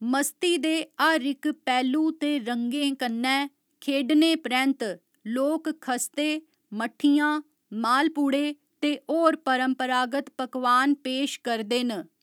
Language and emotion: Dogri, neutral